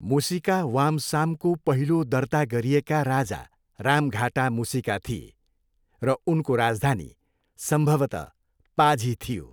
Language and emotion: Nepali, neutral